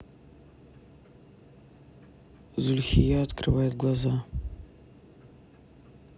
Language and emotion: Russian, neutral